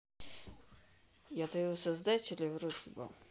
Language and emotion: Russian, neutral